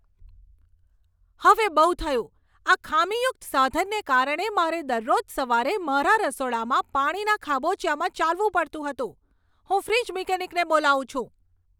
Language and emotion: Gujarati, angry